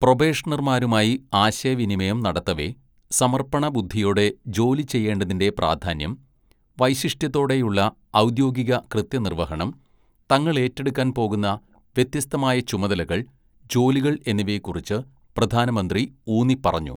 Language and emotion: Malayalam, neutral